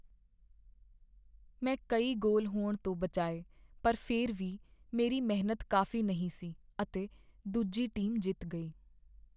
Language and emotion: Punjabi, sad